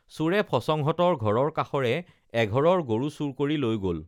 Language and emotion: Assamese, neutral